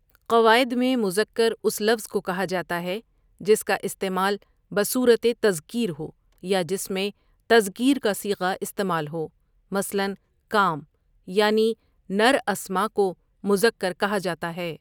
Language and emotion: Urdu, neutral